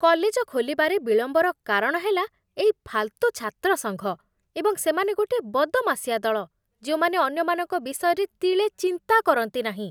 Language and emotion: Odia, disgusted